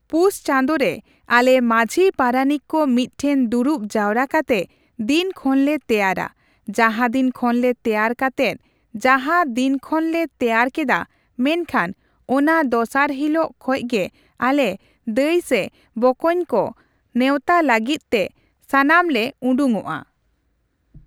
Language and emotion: Santali, neutral